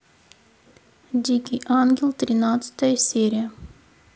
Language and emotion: Russian, neutral